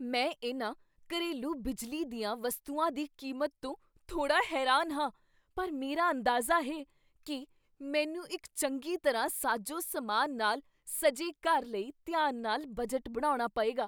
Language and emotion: Punjabi, surprised